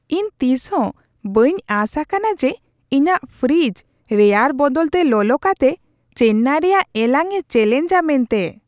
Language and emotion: Santali, surprised